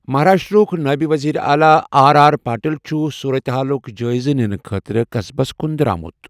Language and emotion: Kashmiri, neutral